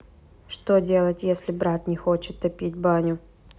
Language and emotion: Russian, neutral